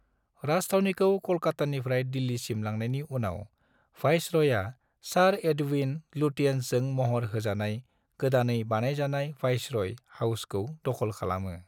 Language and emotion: Bodo, neutral